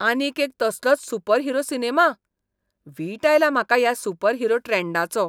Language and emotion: Goan Konkani, disgusted